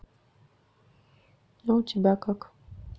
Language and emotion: Russian, sad